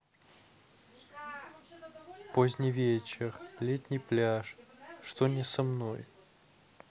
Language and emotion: Russian, neutral